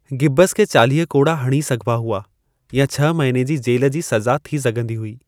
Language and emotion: Sindhi, neutral